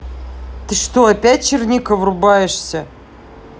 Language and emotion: Russian, angry